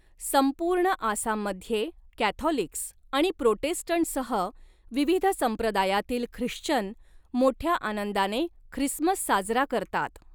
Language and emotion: Marathi, neutral